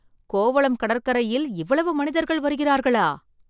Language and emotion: Tamil, surprised